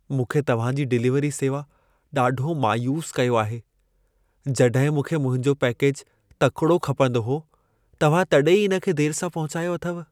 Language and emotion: Sindhi, sad